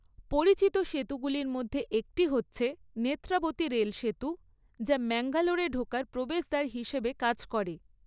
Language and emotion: Bengali, neutral